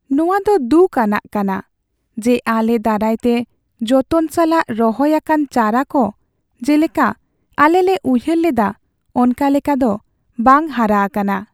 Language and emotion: Santali, sad